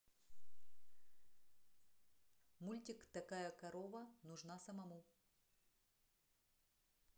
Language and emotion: Russian, neutral